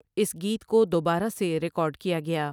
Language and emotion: Urdu, neutral